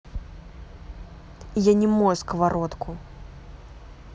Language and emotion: Russian, angry